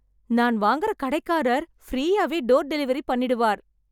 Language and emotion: Tamil, happy